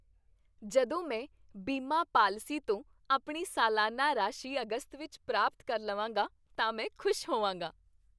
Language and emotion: Punjabi, happy